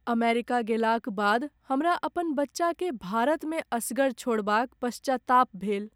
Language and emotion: Maithili, sad